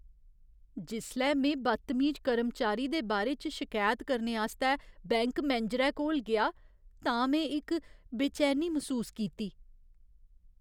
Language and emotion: Dogri, fearful